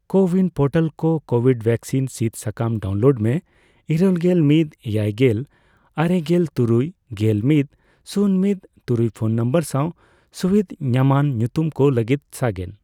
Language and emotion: Santali, neutral